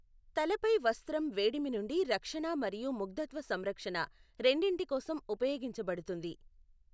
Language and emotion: Telugu, neutral